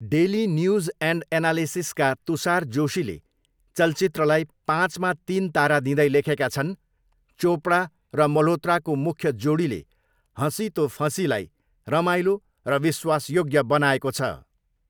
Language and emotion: Nepali, neutral